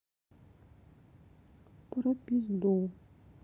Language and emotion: Russian, neutral